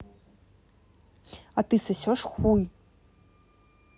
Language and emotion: Russian, angry